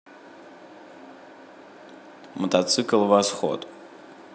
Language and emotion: Russian, neutral